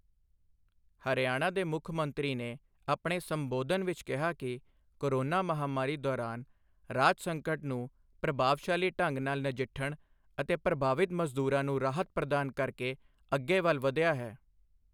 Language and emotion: Punjabi, neutral